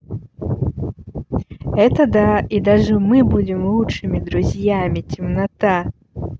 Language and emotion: Russian, positive